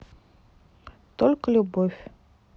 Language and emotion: Russian, neutral